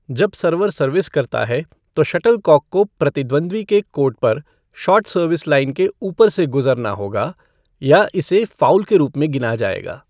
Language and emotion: Hindi, neutral